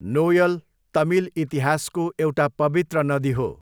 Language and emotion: Nepali, neutral